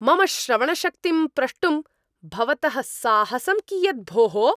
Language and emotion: Sanskrit, angry